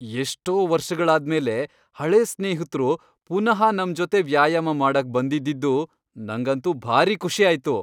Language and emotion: Kannada, happy